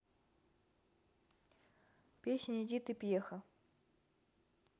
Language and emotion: Russian, neutral